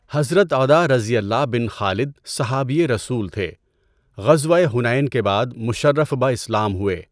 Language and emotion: Urdu, neutral